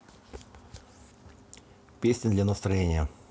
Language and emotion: Russian, neutral